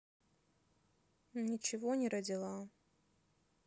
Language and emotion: Russian, sad